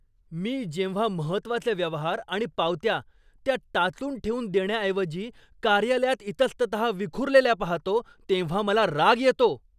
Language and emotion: Marathi, angry